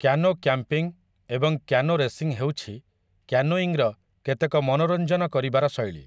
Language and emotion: Odia, neutral